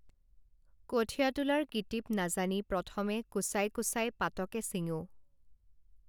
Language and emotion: Assamese, neutral